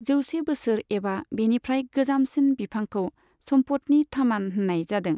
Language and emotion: Bodo, neutral